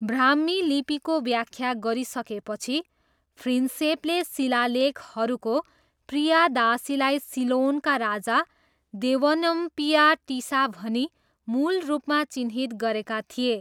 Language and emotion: Nepali, neutral